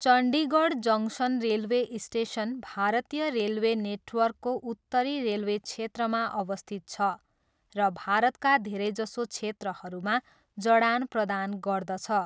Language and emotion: Nepali, neutral